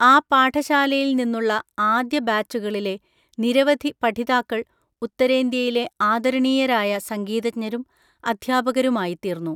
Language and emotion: Malayalam, neutral